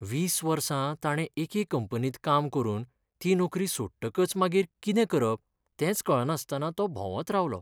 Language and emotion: Goan Konkani, sad